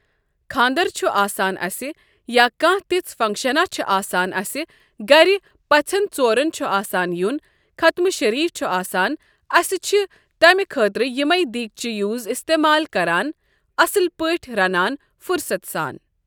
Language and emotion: Kashmiri, neutral